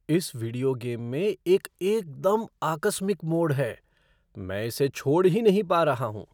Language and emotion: Hindi, surprised